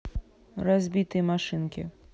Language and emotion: Russian, neutral